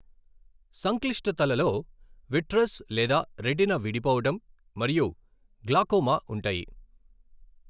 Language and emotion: Telugu, neutral